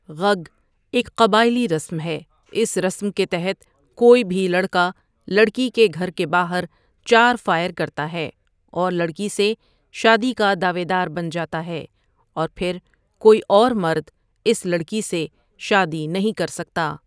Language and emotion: Urdu, neutral